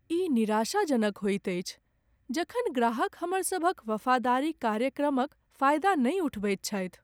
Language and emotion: Maithili, sad